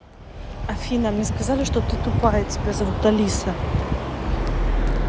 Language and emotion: Russian, angry